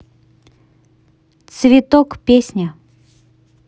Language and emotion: Russian, neutral